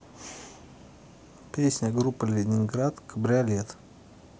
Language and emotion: Russian, neutral